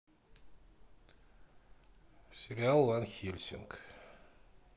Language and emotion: Russian, neutral